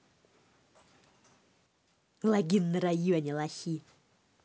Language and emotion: Russian, angry